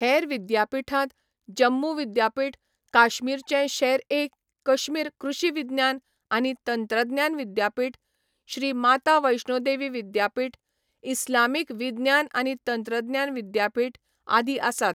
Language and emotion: Goan Konkani, neutral